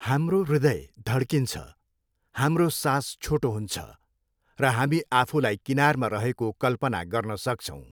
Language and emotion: Nepali, neutral